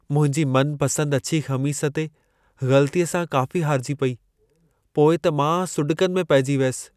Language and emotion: Sindhi, sad